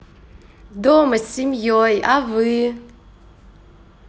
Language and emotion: Russian, positive